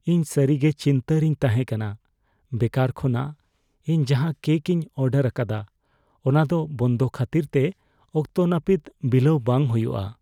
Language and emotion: Santali, fearful